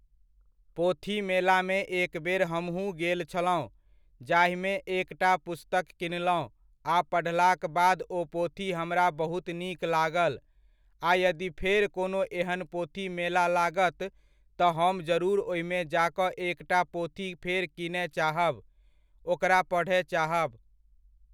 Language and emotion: Maithili, neutral